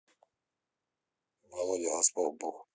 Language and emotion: Russian, neutral